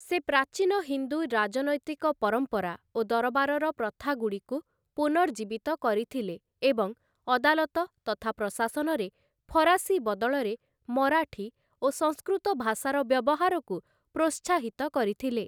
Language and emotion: Odia, neutral